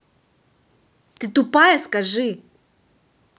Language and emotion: Russian, angry